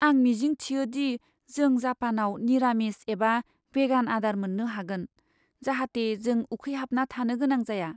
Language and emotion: Bodo, fearful